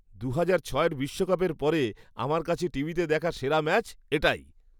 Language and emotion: Bengali, happy